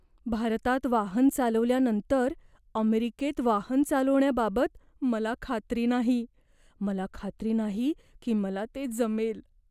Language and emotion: Marathi, fearful